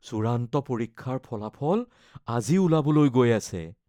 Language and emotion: Assamese, fearful